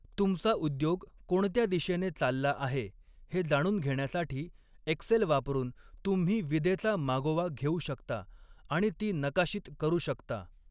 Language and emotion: Marathi, neutral